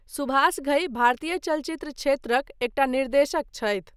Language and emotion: Maithili, neutral